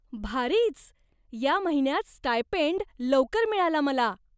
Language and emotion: Marathi, surprised